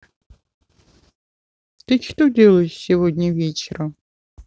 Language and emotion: Russian, neutral